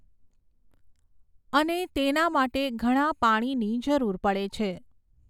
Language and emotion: Gujarati, neutral